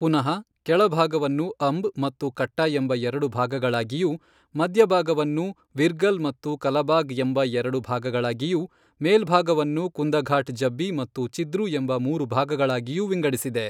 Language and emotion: Kannada, neutral